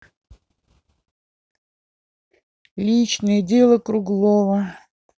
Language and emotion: Russian, neutral